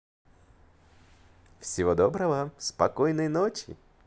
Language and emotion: Russian, positive